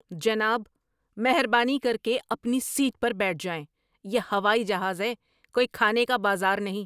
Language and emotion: Urdu, angry